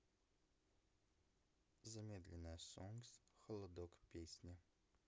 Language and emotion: Russian, neutral